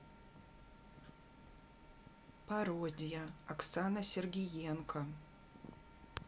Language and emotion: Russian, neutral